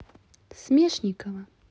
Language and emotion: Russian, neutral